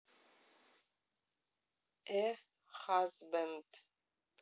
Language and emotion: Russian, neutral